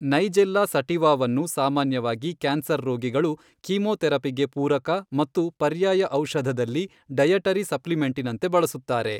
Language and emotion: Kannada, neutral